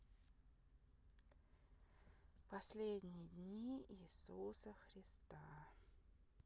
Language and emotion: Russian, neutral